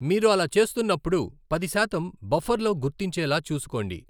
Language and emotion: Telugu, neutral